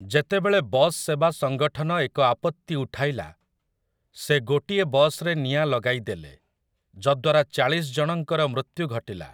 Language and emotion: Odia, neutral